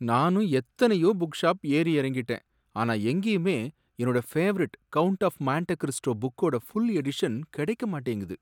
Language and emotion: Tamil, sad